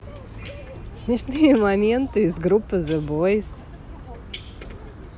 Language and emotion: Russian, positive